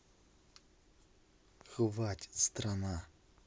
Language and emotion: Russian, angry